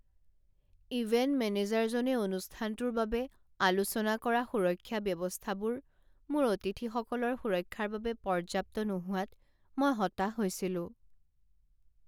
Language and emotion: Assamese, sad